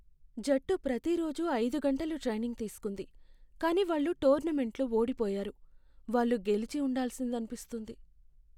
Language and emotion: Telugu, sad